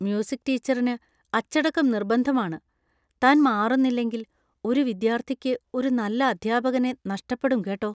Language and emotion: Malayalam, fearful